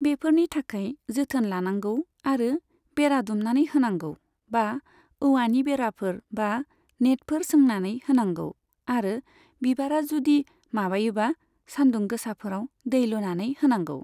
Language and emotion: Bodo, neutral